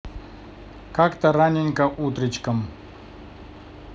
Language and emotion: Russian, neutral